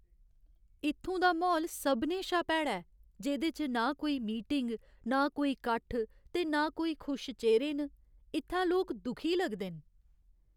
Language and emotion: Dogri, sad